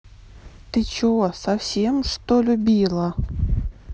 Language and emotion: Russian, neutral